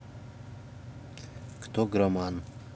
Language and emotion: Russian, neutral